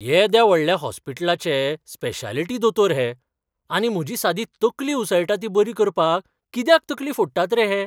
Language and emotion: Goan Konkani, surprised